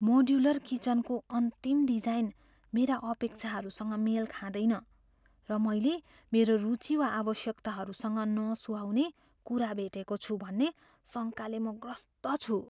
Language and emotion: Nepali, fearful